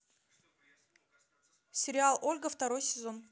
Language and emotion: Russian, neutral